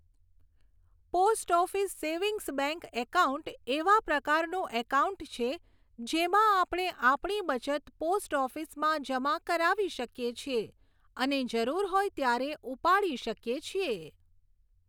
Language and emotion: Gujarati, neutral